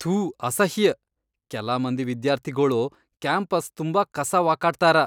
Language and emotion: Kannada, disgusted